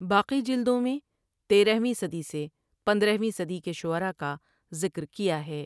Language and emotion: Urdu, neutral